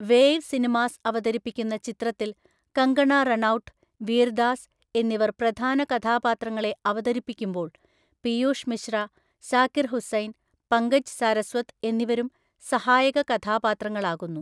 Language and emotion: Malayalam, neutral